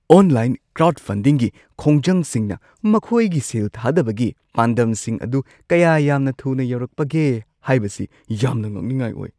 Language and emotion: Manipuri, surprised